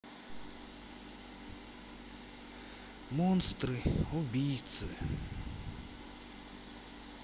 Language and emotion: Russian, sad